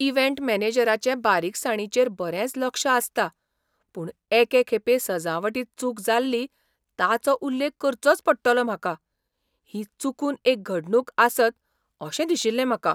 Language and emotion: Goan Konkani, surprised